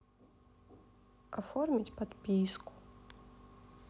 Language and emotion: Russian, neutral